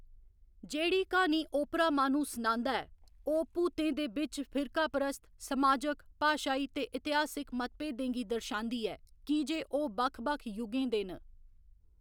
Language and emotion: Dogri, neutral